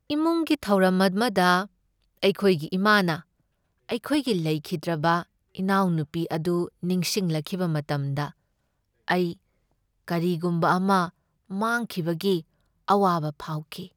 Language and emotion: Manipuri, sad